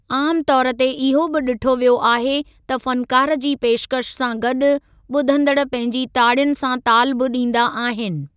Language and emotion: Sindhi, neutral